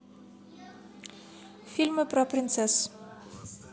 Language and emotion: Russian, neutral